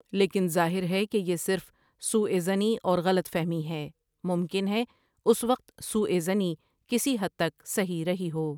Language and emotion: Urdu, neutral